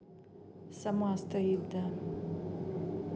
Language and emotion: Russian, neutral